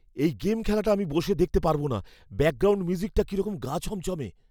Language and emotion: Bengali, fearful